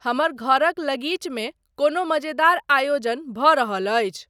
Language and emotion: Maithili, neutral